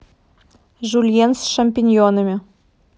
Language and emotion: Russian, neutral